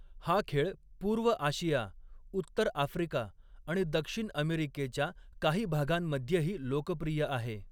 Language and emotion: Marathi, neutral